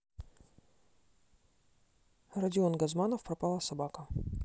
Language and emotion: Russian, neutral